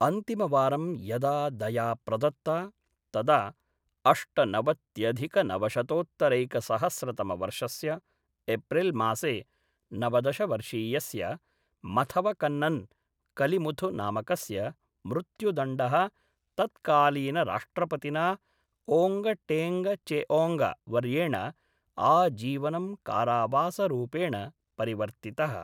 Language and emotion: Sanskrit, neutral